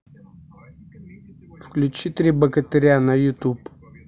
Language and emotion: Russian, neutral